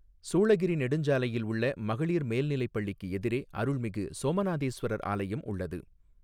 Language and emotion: Tamil, neutral